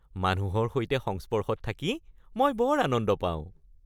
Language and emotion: Assamese, happy